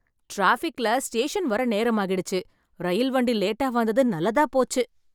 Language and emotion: Tamil, happy